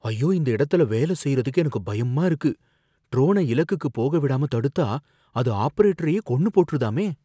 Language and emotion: Tamil, fearful